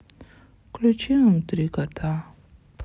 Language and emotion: Russian, sad